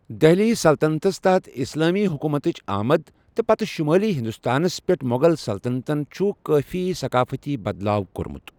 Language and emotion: Kashmiri, neutral